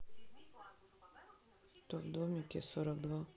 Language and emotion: Russian, neutral